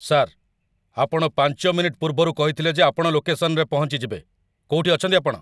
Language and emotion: Odia, angry